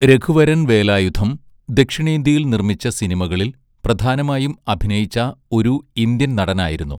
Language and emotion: Malayalam, neutral